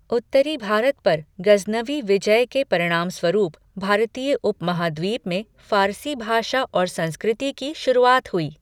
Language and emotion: Hindi, neutral